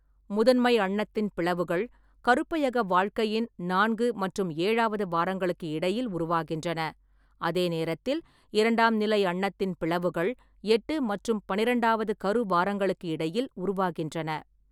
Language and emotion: Tamil, neutral